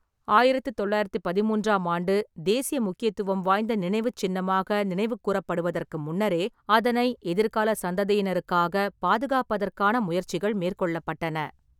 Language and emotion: Tamil, neutral